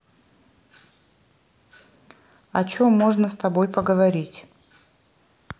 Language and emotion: Russian, neutral